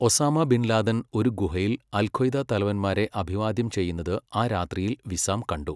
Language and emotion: Malayalam, neutral